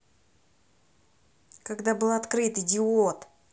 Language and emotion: Russian, angry